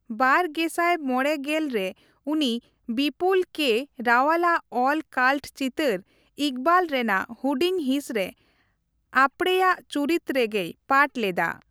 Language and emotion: Santali, neutral